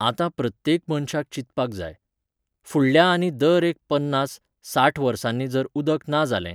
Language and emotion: Goan Konkani, neutral